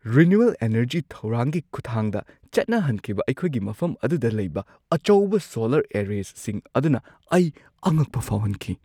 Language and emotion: Manipuri, surprised